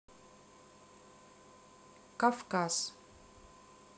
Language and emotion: Russian, neutral